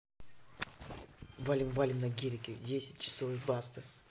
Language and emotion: Russian, neutral